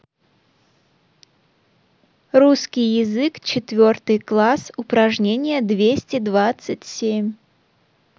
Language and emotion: Russian, neutral